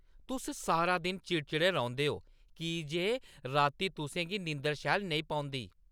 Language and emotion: Dogri, angry